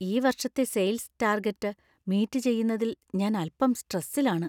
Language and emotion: Malayalam, fearful